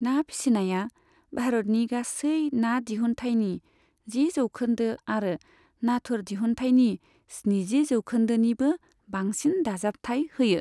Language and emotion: Bodo, neutral